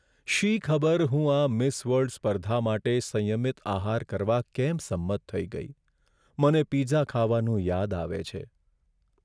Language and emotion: Gujarati, sad